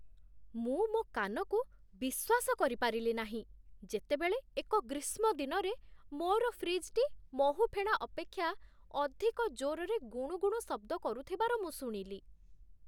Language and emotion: Odia, surprised